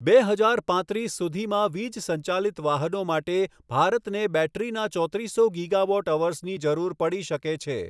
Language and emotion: Gujarati, neutral